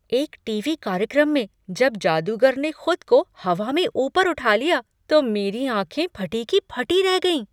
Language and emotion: Hindi, surprised